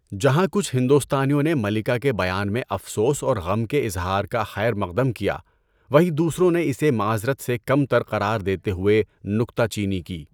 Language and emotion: Urdu, neutral